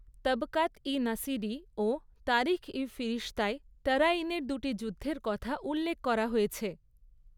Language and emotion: Bengali, neutral